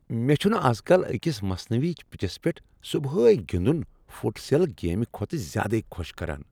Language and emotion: Kashmiri, happy